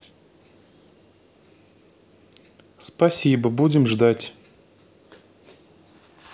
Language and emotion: Russian, neutral